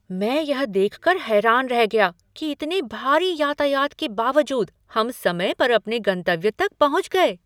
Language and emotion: Hindi, surprised